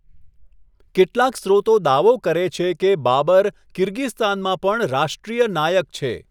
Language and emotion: Gujarati, neutral